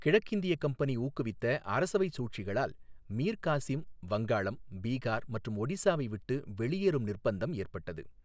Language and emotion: Tamil, neutral